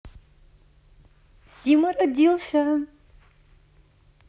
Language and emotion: Russian, positive